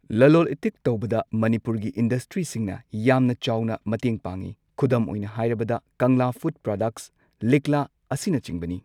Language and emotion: Manipuri, neutral